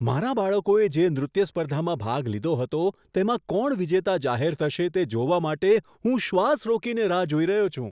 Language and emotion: Gujarati, surprised